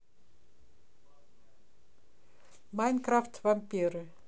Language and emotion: Russian, neutral